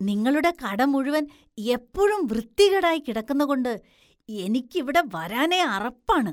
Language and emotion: Malayalam, disgusted